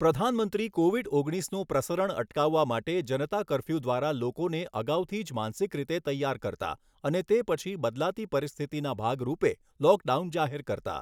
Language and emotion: Gujarati, neutral